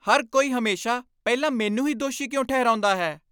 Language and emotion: Punjabi, angry